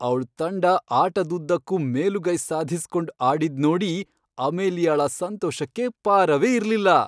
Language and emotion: Kannada, happy